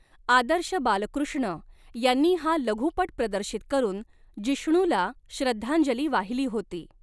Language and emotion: Marathi, neutral